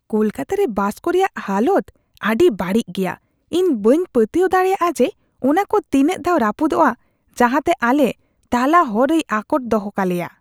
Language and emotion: Santali, disgusted